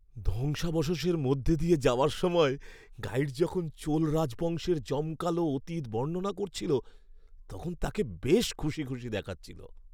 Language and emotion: Bengali, happy